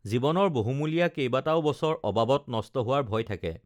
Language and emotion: Assamese, neutral